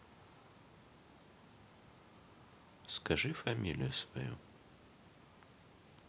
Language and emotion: Russian, neutral